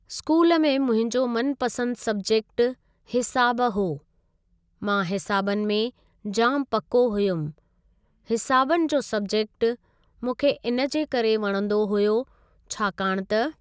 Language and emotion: Sindhi, neutral